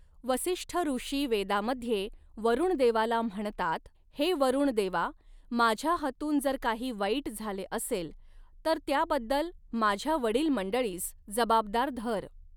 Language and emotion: Marathi, neutral